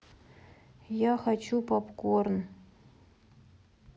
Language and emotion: Russian, neutral